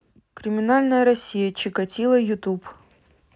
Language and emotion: Russian, neutral